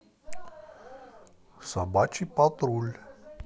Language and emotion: Russian, neutral